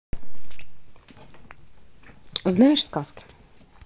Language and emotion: Russian, neutral